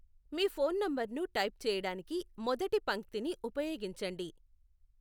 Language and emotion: Telugu, neutral